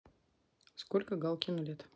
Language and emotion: Russian, neutral